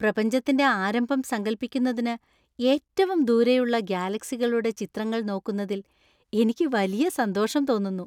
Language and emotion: Malayalam, happy